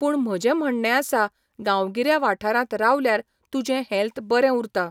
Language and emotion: Goan Konkani, neutral